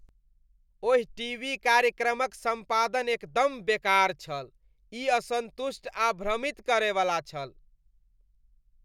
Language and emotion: Maithili, disgusted